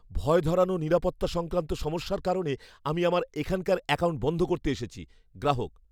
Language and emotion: Bengali, fearful